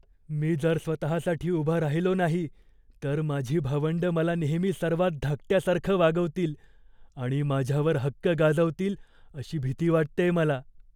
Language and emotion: Marathi, fearful